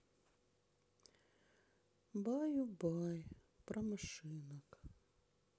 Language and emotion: Russian, sad